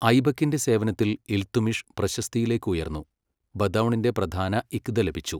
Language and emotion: Malayalam, neutral